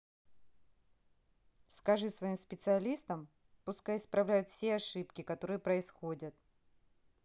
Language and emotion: Russian, neutral